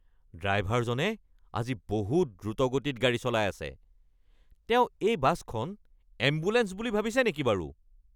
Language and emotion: Assamese, angry